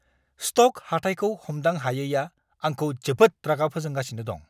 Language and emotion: Bodo, angry